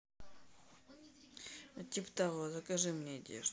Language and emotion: Russian, neutral